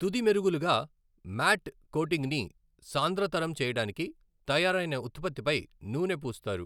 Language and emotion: Telugu, neutral